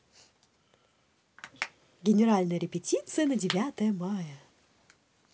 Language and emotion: Russian, positive